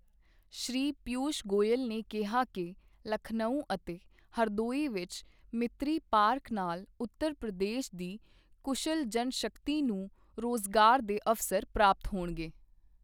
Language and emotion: Punjabi, neutral